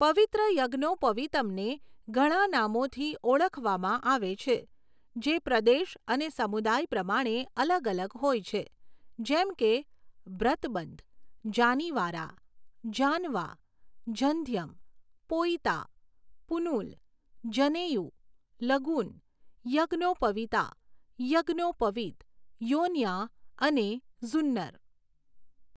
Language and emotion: Gujarati, neutral